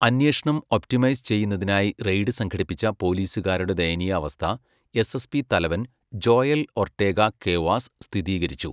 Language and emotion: Malayalam, neutral